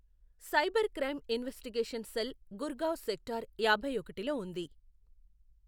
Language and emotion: Telugu, neutral